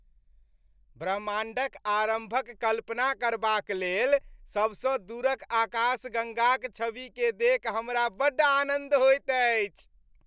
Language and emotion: Maithili, happy